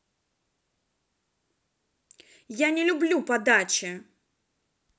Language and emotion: Russian, angry